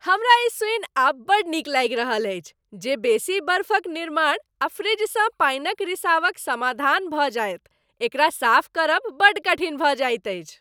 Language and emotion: Maithili, happy